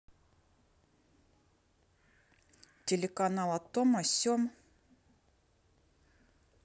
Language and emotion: Russian, neutral